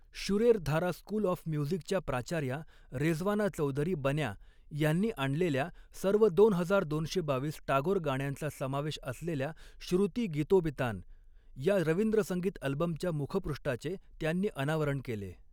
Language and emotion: Marathi, neutral